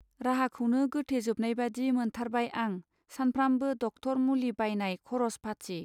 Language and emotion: Bodo, neutral